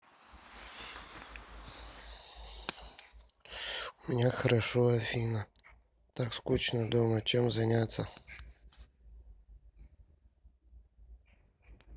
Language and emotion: Russian, neutral